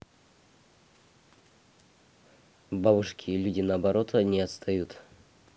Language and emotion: Russian, neutral